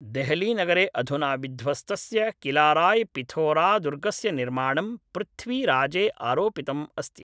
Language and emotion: Sanskrit, neutral